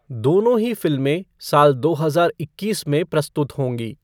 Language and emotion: Hindi, neutral